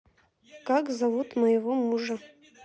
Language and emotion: Russian, neutral